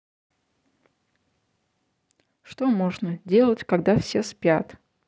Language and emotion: Russian, neutral